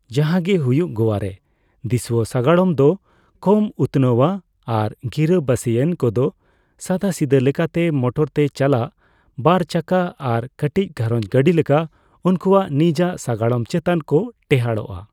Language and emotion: Santali, neutral